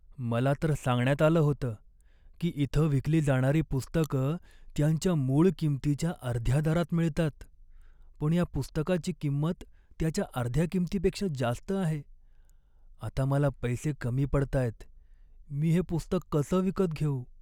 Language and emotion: Marathi, sad